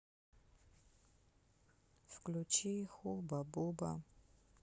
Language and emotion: Russian, sad